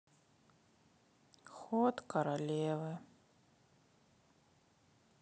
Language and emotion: Russian, sad